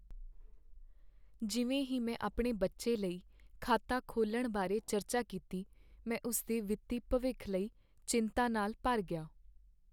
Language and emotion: Punjabi, sad